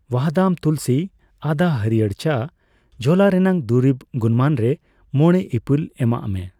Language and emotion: Santali, neutral